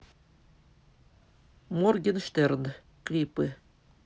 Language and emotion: Russian, neutral